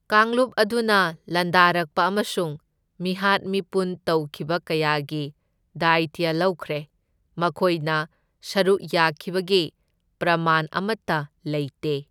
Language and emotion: Manipuri, neutral